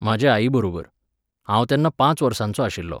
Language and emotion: Goan Konkani, neutral